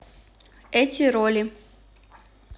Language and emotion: Russian, neutral